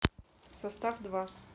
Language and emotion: Russian, neutral